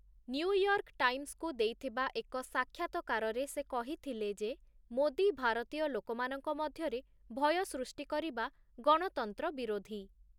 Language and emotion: Odia, neutral